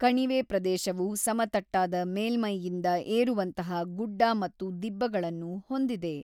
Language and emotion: Kannada, neutral